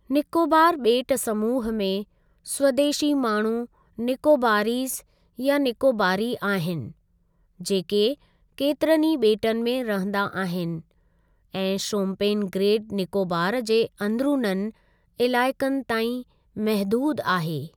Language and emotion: Sindhi, neutral